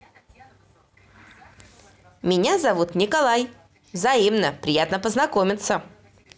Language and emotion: Russian, positive